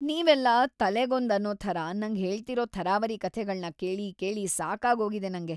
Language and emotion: Kannada, disgusted